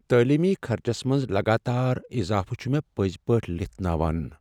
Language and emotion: Kashmiri, sad